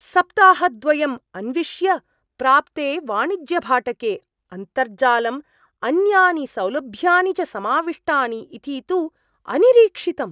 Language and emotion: Sanskrit, surprised